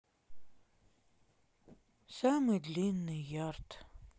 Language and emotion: Russian, sad